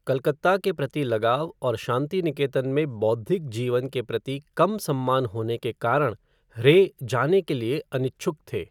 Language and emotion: Hindi, neutral